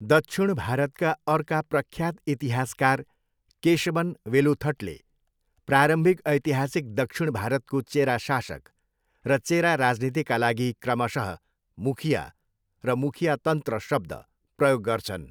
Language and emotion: Nepali, neutral